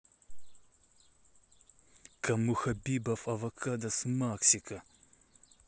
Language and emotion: Russian, angry